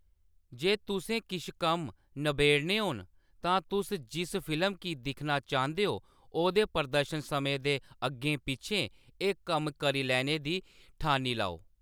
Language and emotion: Dogri, neutral